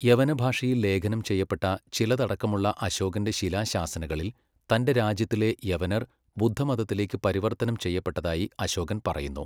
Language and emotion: Malayalam, neutral